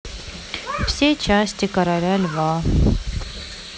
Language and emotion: Russian, sad